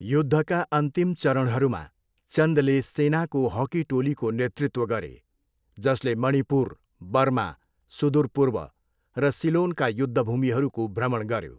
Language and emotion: Nepali, neutral